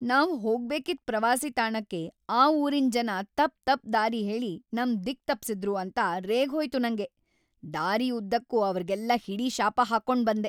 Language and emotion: Kannada, angry